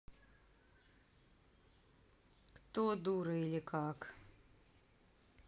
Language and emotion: Russian, neutral